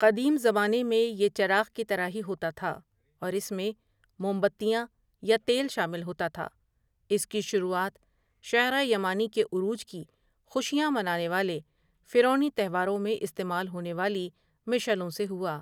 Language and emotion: Urdu, neutral